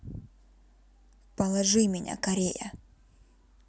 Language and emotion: Russian, neutral